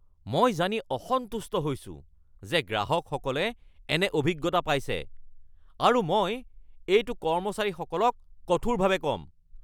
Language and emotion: Assamese, angry